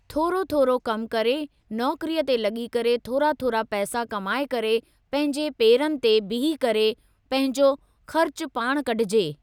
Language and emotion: Sindhi, neutral